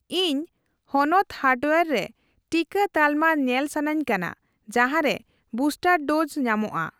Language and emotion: Santali, neutral